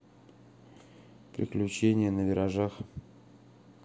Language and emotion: Russian, neutral